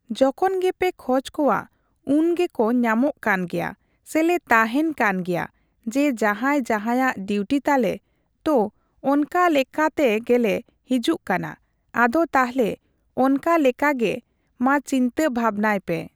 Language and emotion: Santali, neutral